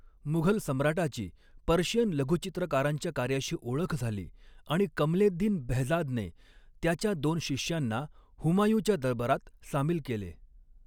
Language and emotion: Marathi, neutral